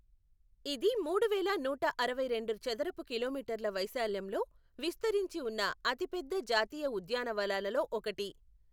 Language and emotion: Telugu, neutral